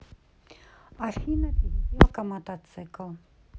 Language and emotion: Russian, neutral